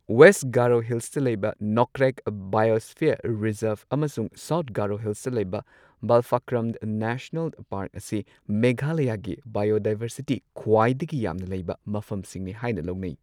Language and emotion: Manipuri, neutral